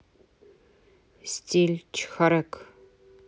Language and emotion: Russian, neutral